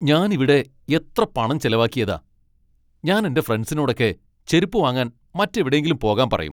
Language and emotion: Malayalam, angry